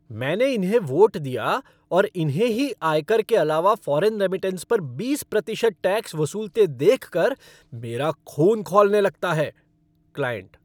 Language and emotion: Hindi, angry